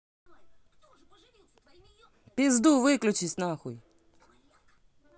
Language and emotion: Russian, angry